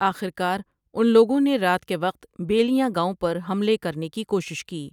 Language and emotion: Urdu, neutral